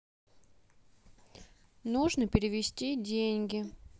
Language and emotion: Russian, neutral